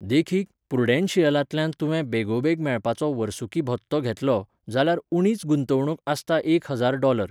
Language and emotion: Goan Konkani, neutral